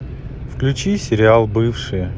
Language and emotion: Russian, neutral